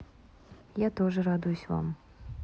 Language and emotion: Russian, neutral